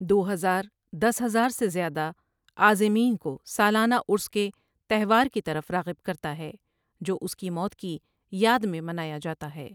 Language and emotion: Urdu, neutral